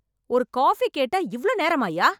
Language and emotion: Tamil, angry